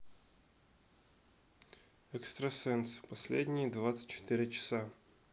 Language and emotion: Russian, neutral